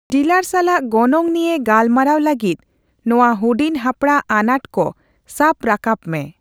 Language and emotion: Santali, neutral